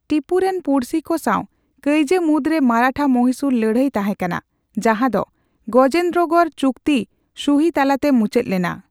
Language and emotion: Santali, neutral